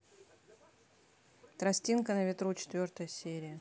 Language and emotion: Russian, neutral